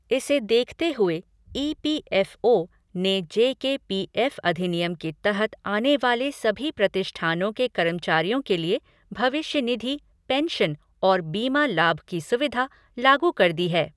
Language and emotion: Hindi, neutral